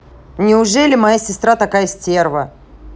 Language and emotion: Russian, angry